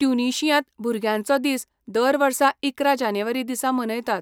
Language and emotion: Goan Konkani, neutral